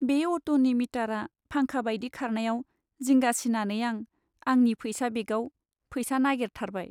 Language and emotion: Bodo, sad